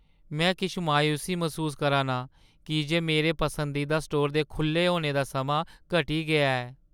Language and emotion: Dogri, sad